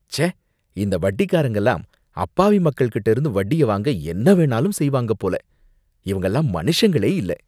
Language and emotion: Tamil, disgusted